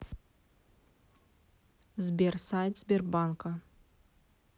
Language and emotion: Russian, neutral